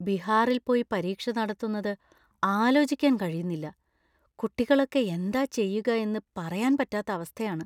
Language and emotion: Malayalam, fearful